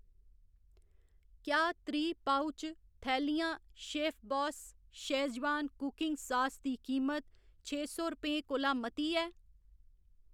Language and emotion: Dogri, neutral